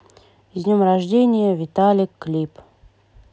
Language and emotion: Russian, neutral